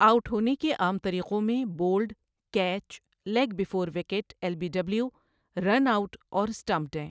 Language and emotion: Urdu, neutral